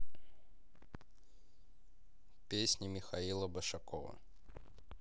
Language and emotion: Russian, neutral